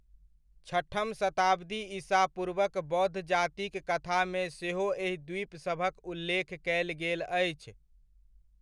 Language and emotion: Maithili, neutral